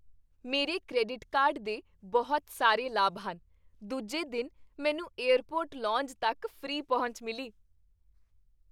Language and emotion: Punjabi, happy